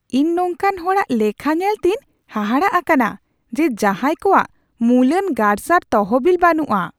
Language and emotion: Santali, surprised